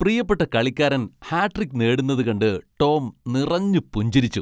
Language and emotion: Malayalam, happy